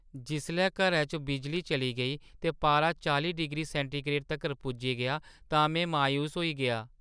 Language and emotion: Dogri, sad